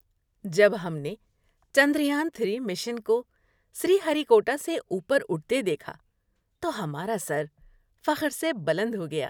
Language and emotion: Urdu, happy